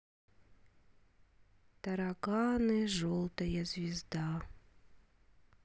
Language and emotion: Russian, sad